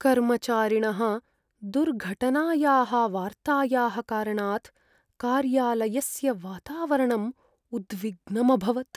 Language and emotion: Sanskrit, sad